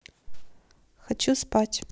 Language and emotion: Russian, neutral